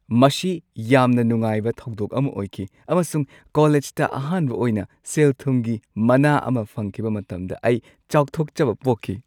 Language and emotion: Manipuri, happy